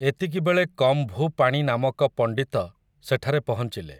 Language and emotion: Odia, neutral